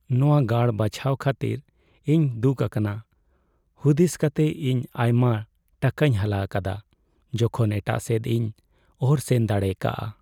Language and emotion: Santali, sad